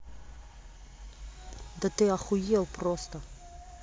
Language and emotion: Russian, angry